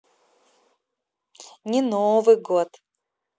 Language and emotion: Russian, positive